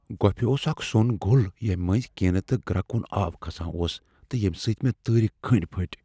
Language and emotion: Kashmiri, fearful